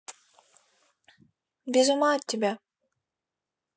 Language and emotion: Russian, positive